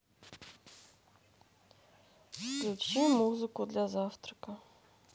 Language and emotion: Russian, neutral